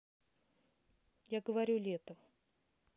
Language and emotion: Russian, neutral